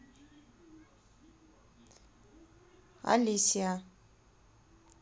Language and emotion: Russian, neutral